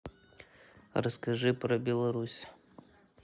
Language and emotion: Russian, neutral